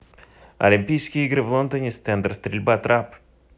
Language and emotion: Russian, neutral